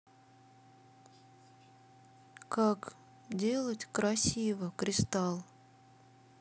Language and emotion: Russian, sad